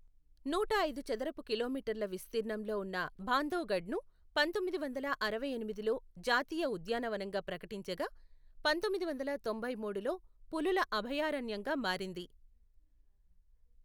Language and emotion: Telugu, neutral